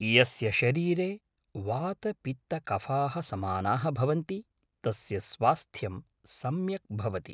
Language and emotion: Sanskrit, neutral